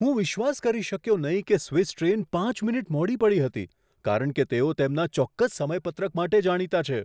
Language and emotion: Gujarati, surprised